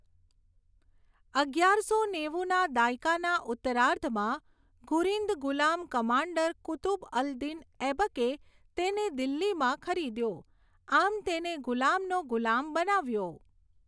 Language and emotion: Gujarati, neutral